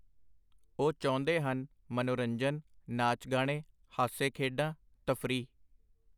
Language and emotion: Punjabi, neutral